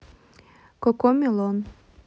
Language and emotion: Russian, neutral